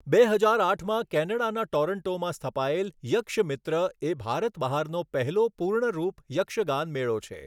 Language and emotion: Gujarati, neutral